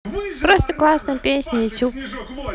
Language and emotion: Russian, neutral